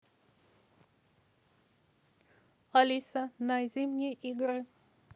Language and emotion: Russian, neutral